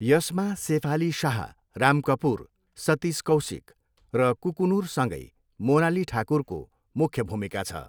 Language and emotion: Nepali, neutral